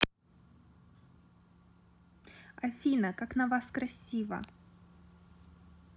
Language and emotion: Russian, positive